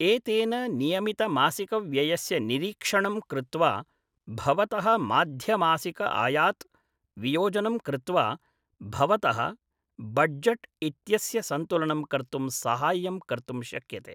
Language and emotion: Sanskrit, neutral